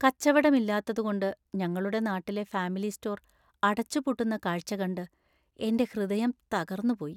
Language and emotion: Malayalam, sad